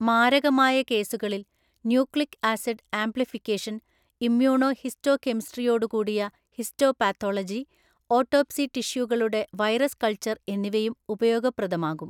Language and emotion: Malayalam, neutral